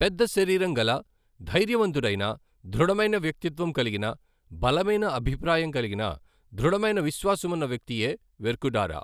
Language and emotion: Telugu, neutral